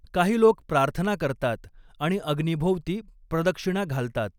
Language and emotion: Marathi, neutral